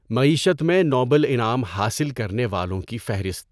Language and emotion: Urdu, neutral